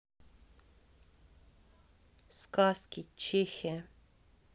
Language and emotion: Russian, neutral